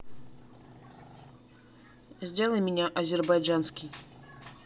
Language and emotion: Russian, neutral